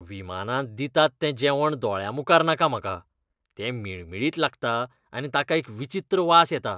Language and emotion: Goan Konkani, disgusted